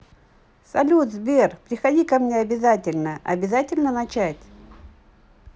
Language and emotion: Russian, positive